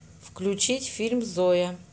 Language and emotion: Russian, neutral